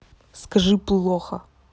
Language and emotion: Russian, angry